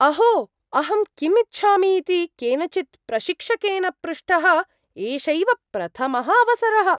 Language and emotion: Sanskrit, surprised